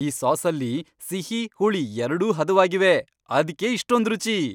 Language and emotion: Kannada, happy